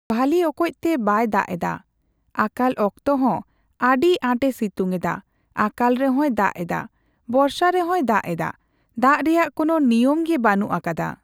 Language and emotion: Santali, neutral